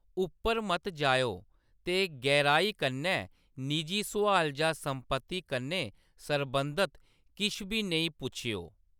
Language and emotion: Dogri, neutral